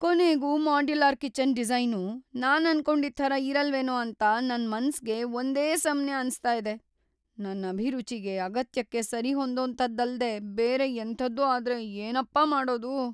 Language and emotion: Kannada, fearful